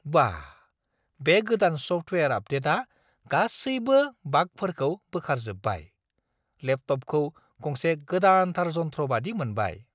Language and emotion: Bodo, surprised